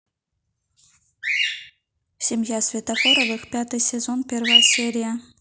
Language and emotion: Russian, neutral